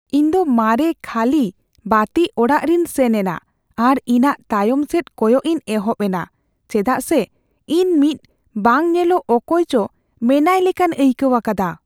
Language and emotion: Santali, fearful